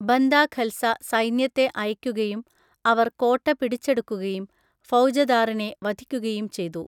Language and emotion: Malayalam, neutral